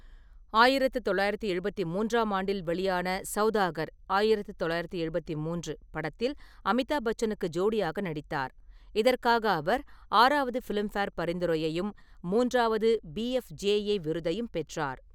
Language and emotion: Tamil, neutral